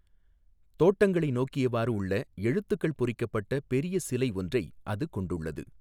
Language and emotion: Tamil, neutral